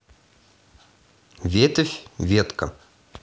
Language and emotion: Russian, neutral